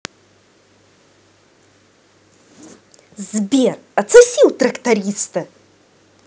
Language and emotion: Russian, angry